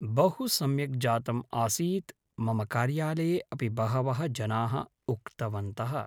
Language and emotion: Sanskrit, neutral